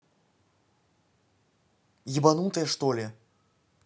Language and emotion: Russian, angry